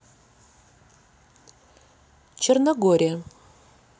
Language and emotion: Russian, neutral